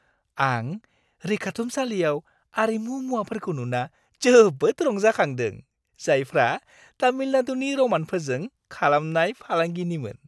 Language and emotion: Bodo, happy